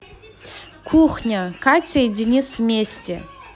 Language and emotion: Russian, positive